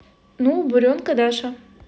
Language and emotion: Russian, positive